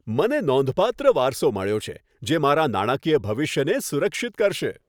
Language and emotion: Gujarati, happy